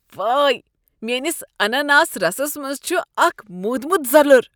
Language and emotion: Kashmiri, disgusted